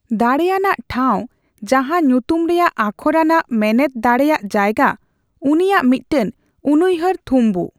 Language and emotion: Santali, neutral